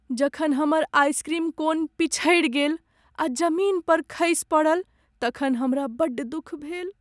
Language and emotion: Maithili, sad